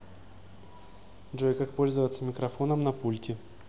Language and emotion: Russian, neutral